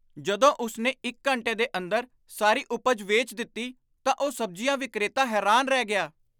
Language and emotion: Punjabi, surprised